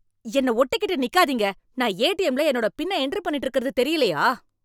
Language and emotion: Tamil, angry